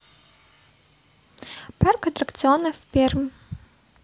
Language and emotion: Russian, neutral